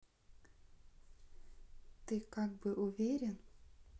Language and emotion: Russian, neutral